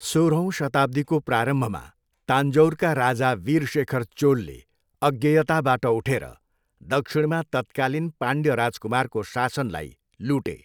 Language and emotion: Nepali, neutral